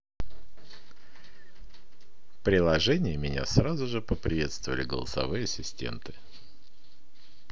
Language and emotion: Russian, positive